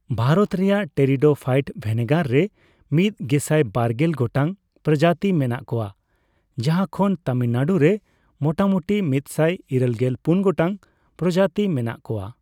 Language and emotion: Santali, neutral